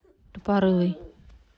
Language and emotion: Russian, neutral